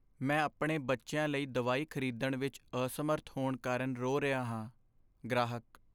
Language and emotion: Punjabi, sad